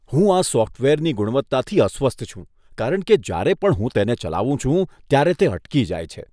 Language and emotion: Gujarati, disgusted